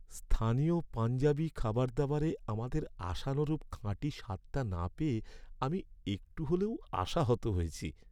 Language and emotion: Bengali, sad